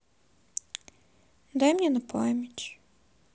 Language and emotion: Russian, sad